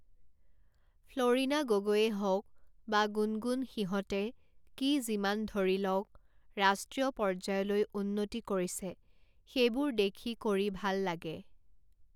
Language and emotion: Assamese, neutral